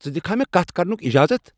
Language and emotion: Kashmiri, angry